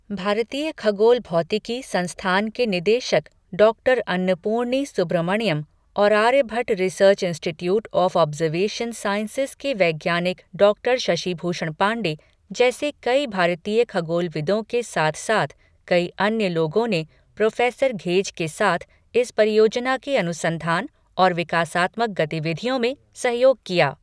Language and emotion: Hindi, neutral